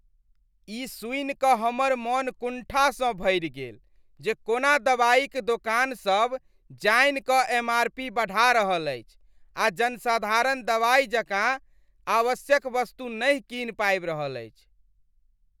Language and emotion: Maithili, disgusted